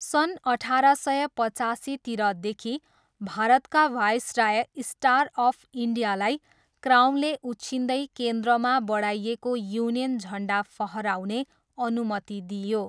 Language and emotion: Nepali, neutral